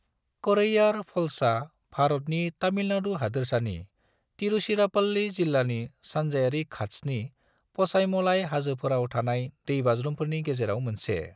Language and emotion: Bodo, neutral